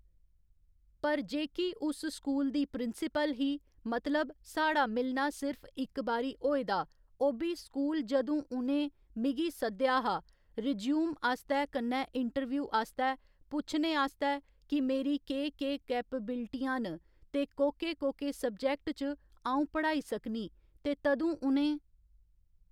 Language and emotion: Dogri, neutral